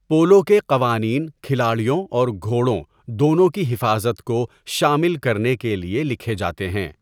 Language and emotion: Urdu, neutral